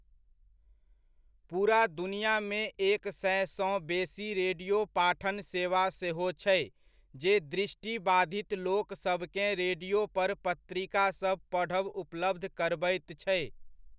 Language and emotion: Maithili, neutral